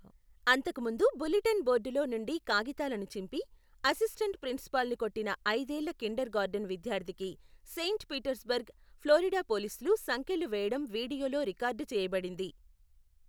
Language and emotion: Telugu, neutral